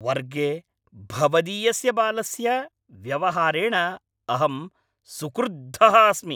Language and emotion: Sanskrit, angry